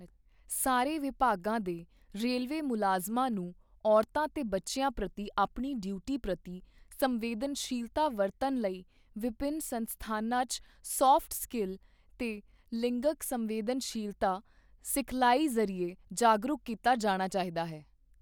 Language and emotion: Punjabi, neutral